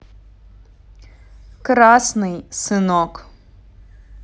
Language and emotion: Russian, neutral